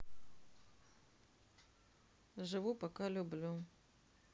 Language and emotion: Russian, neutral